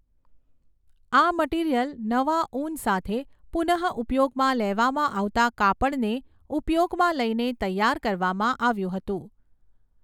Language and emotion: Gujarati, neutral